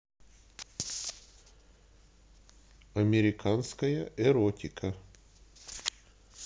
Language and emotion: Russian, neutral